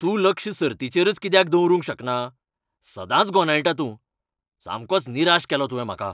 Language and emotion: Goan Konkani, angry